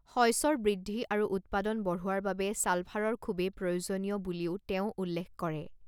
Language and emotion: Assamese, neutral